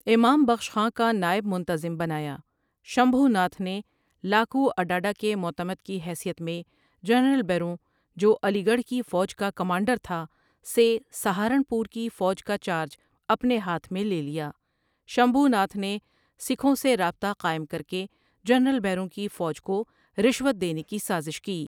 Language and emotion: Urdu, neutral